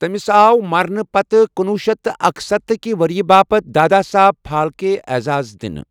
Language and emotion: Kashmiri, neutral